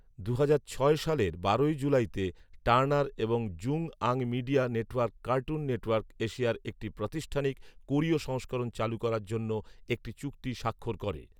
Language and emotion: Bengali, neutral